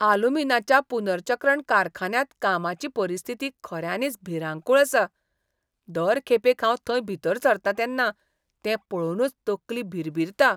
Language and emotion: Goan Konkani, disgusted